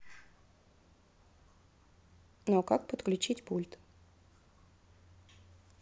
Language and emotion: Russian, neutral